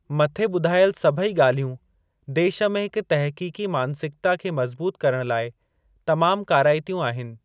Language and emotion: Sindhi, neutral